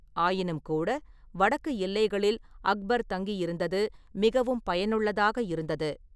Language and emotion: Tamil, neutral